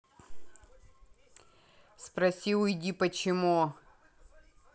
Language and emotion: Russian, angry